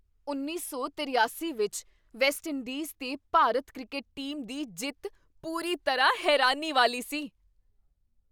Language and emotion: Punjabi, surprised